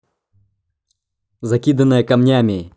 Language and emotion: Russian, angry